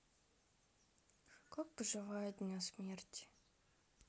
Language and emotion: Russian, sad